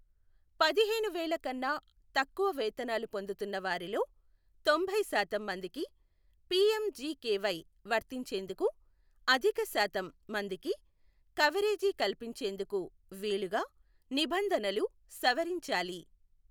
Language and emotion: Telugu, neutral